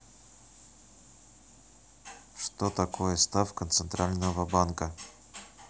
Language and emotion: Russian, neutral